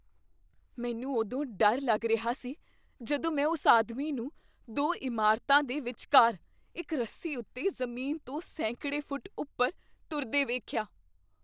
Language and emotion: Punjabi, fearful